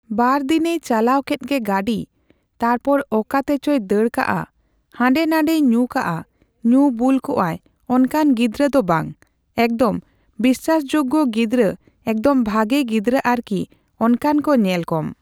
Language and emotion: Santali, neutral